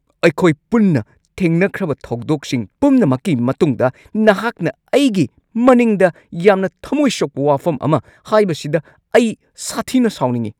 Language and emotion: Manipuri, angry